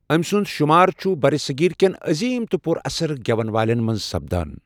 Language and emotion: Kashmiri, neutral